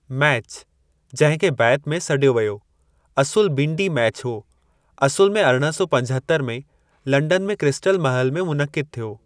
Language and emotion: Sindhi, neutral